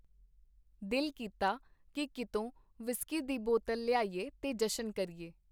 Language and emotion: Punjabi, neutral